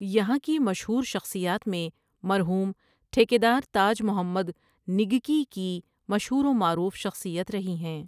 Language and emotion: Urdu, neutral